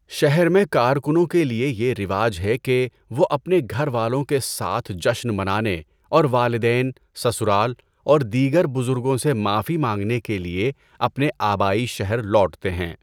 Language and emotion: Urdu, neutral